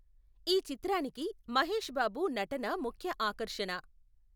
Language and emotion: Telugu, neutral